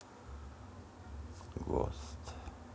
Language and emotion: Russian, neutral